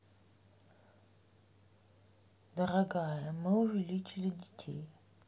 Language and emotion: Russian, neutral